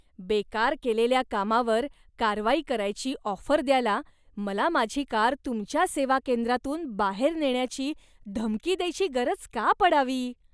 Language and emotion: Marathi, disgusted